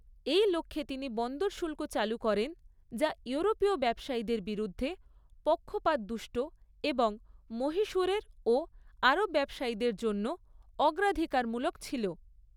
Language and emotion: Bengali, neutral